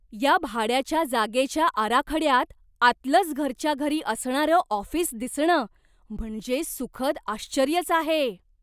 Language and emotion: Marathi, surprised